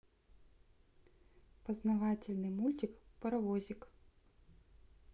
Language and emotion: Russian, neutral